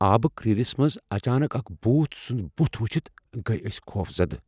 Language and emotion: Kashmiri, fearful